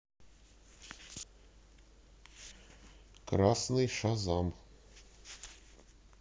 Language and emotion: Russian, neutral